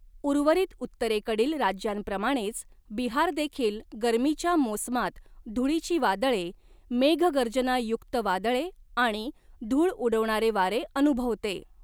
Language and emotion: Marathi, neutral